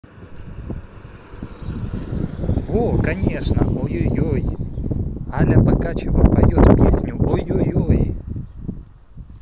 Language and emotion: Russian, positive